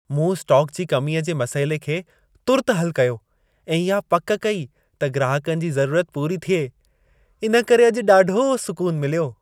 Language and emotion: Sindhi, happy